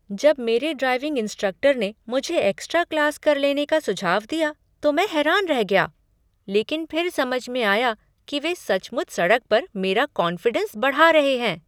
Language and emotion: Hindi, surprised